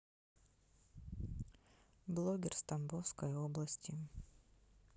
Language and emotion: Russian, neutral